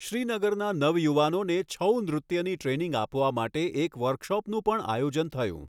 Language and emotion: Gujarati, neutral